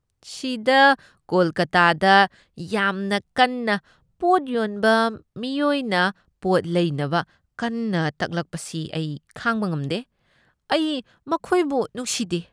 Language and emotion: Manipuri, disgusted